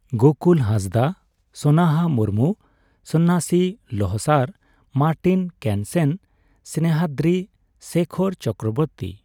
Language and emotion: Santali, neutral